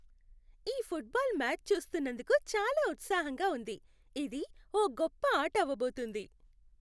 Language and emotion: Telugu, happy